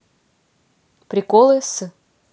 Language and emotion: Russian, neutral